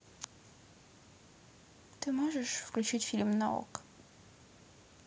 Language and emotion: Russian, neutral